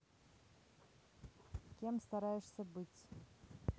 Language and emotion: Russian, neutral